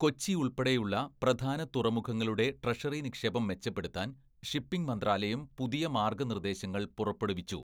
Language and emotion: Malayalam, neutral